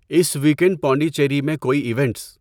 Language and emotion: Urdu, neutral